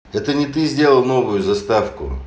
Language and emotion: Russian, neutral